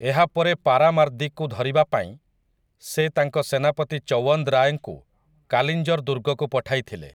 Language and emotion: Odia, neutral